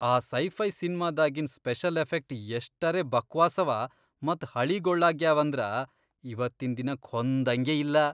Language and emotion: Kannada, disgusted